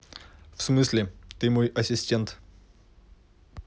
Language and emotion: Russian, neutral